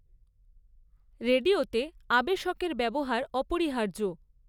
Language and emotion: Bengali, neutral